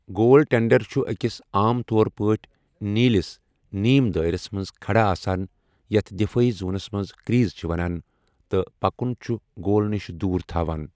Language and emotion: Kashmiri, neutral